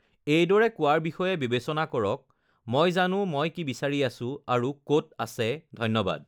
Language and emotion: Assamese, neutral